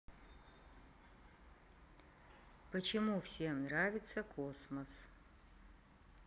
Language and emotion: Russian, neutral